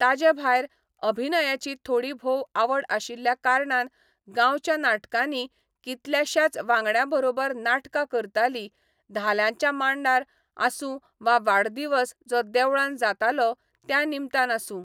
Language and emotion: Goan Konkani, neutral